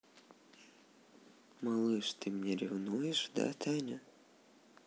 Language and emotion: Russian, neutral